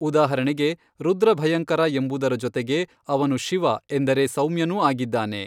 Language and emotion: Kannada, neutral